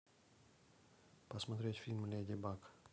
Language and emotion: Russian, neutral